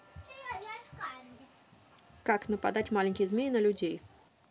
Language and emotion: Russian, neutral